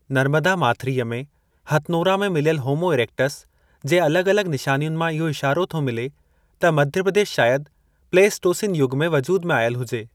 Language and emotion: Sindhi, neutral